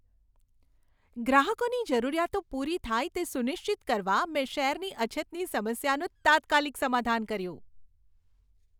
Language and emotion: Gujarati, happy